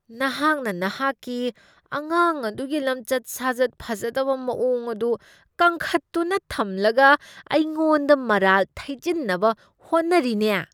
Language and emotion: Manipuri, disgusted